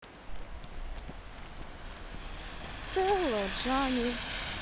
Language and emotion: Russian, sad